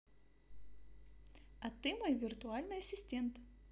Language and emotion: Russian, positive